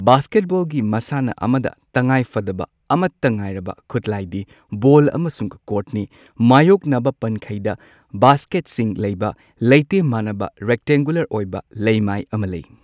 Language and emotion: Manipuri, neutral